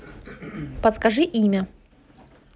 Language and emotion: Russian, neutral